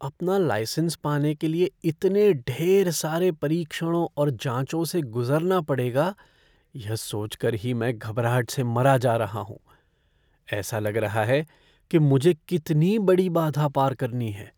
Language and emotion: Hindi, fearful